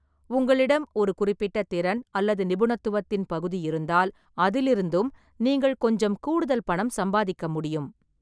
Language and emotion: Tamil, neutral